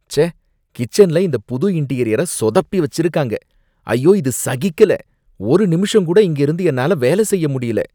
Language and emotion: Tamil, disgusted